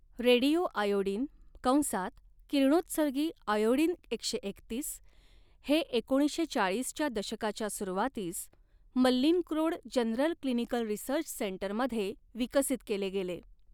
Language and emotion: Marathi, neutral